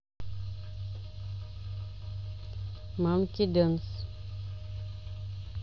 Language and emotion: Russian, neutral